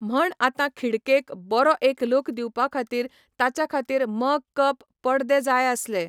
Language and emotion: Goan Konkani, neutral